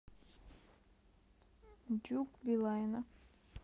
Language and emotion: Russian, neutral